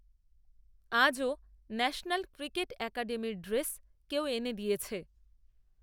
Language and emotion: Bengali, neutral